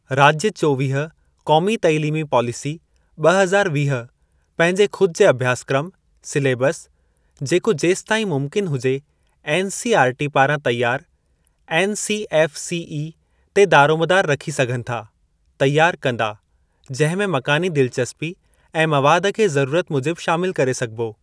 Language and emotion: Sindhi, neutral